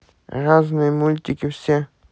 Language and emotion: Russian, neutral